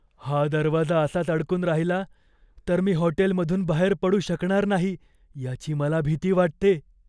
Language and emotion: Marathi, fearful